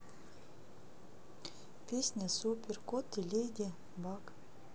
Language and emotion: Russian, neutral